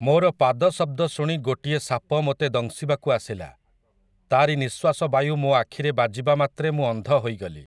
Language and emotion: Odia, neutral